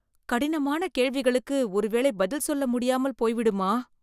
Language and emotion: Tamil, fearful